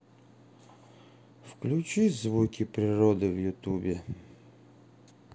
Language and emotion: Russian, sad